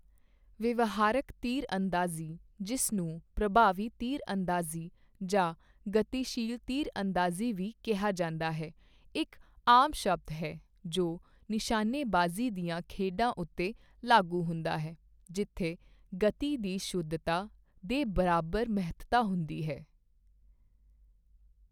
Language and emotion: Punjabi, neutral